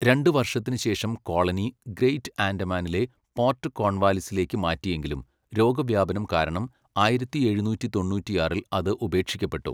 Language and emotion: Malayalam, neutral